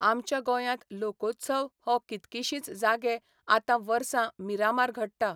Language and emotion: Goan Konkani, neutral